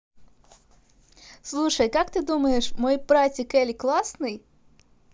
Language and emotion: Russian, positive